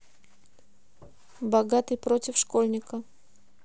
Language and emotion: Russian, neutral